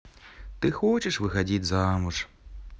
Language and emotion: Russian, sad